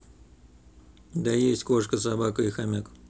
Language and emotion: Russian, neutral